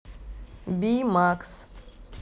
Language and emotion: Russian, neutral